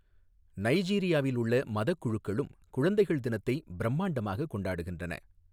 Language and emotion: Tamil, neutral